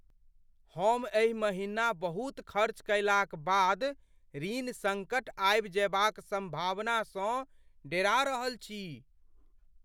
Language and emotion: Maithili, fearful